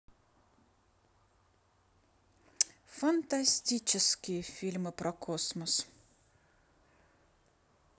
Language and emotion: Russian, positive